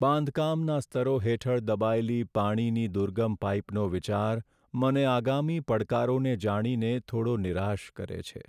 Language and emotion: Gujarati, sad